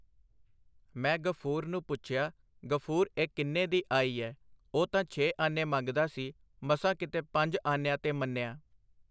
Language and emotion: Punjabi, neutral